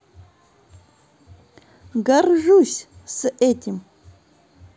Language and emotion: Russian, positive